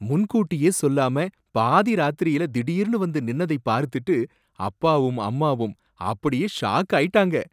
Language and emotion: Tamil, surprised